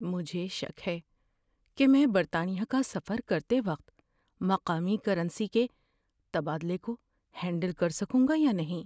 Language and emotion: Urdu, fearful